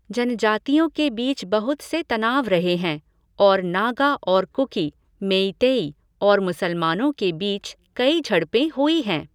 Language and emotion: Hindi, neutral